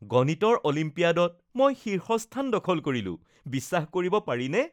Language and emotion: Assamese, happy